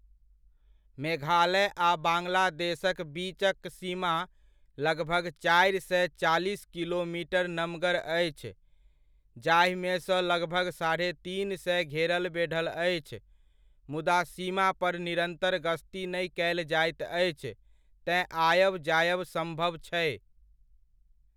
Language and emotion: Maithili, neutral